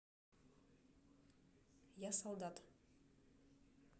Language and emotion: Russian, neutral